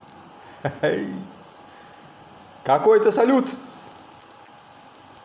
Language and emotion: Russian, positive